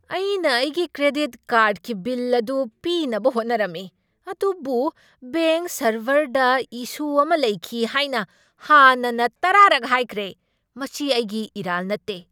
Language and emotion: Manipuri, angry